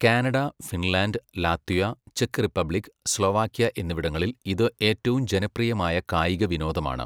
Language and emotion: Malayalam, neutral